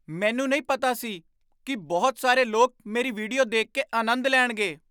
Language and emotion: Punjabi, surprised